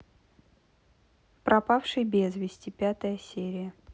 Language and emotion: Russian, neutral